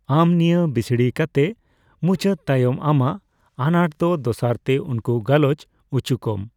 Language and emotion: Santali, neutral